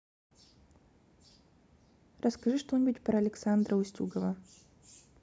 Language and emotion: Russian, neutral